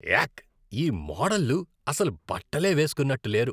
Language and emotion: Telugu, disgusted